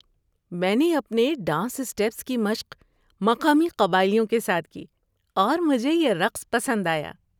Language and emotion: Urdu, happy